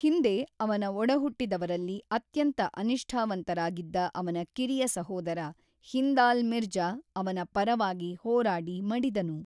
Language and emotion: Kannada, neutral